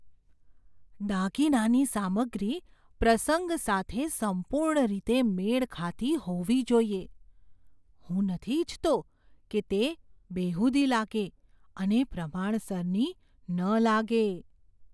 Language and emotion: Gujarati, fearful